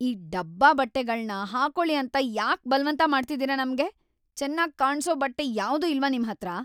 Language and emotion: Kannada, angry